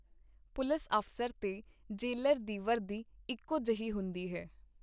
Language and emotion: Punjabi, neutral